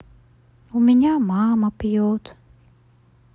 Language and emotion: Russian, sad